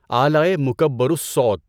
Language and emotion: Urdu, neutral